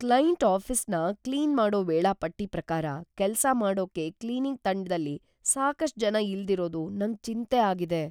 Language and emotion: Kannada, fearful